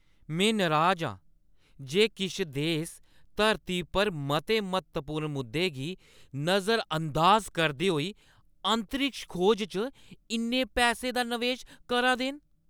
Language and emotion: Dogri, angry